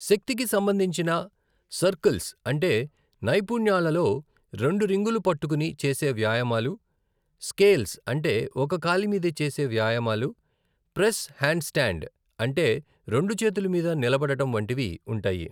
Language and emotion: Telugu, neutral